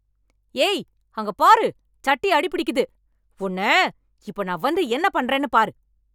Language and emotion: Tamil, angry